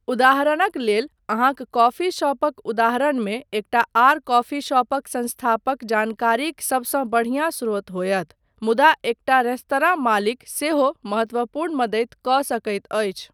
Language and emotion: Maithili, neutral